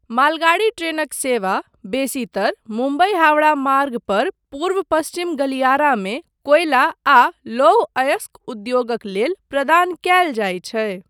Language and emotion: Maithili, neutral